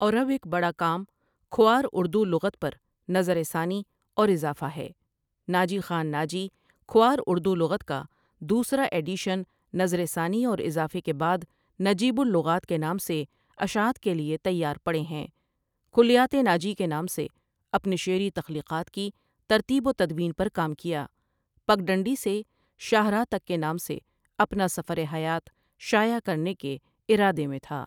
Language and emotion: Urdu, neutral